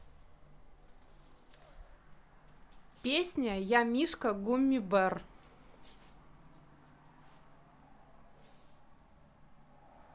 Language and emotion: Russian, neutral